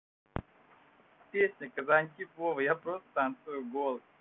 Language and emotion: Russian, neutral